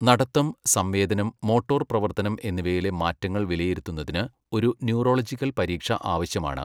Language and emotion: Malayalam, neutral